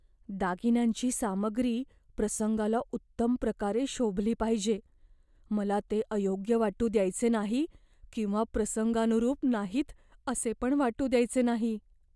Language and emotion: Marathi, fearful